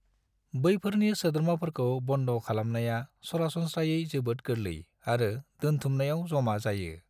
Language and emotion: Bodo, neutral